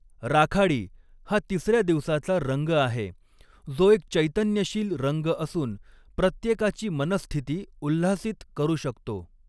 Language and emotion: Marathi, neutral